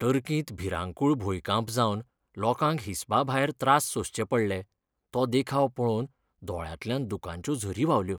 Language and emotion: Goan Konkani, sad